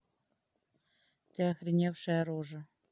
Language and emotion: Russian, neutral